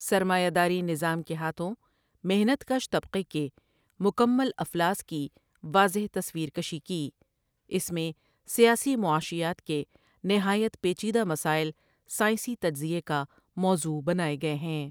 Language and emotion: Urdu, neutral